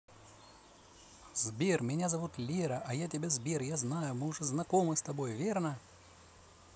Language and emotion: Russian, positive